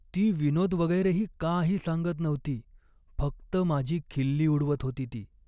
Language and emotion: Marathi, sad